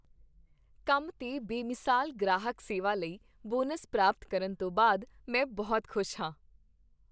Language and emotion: Punjabi, happy